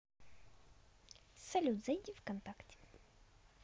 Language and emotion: Russian, positive